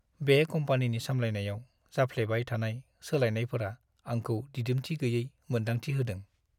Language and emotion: Bodo, sad